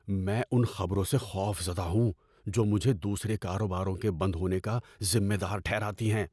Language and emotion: Urdu, fearful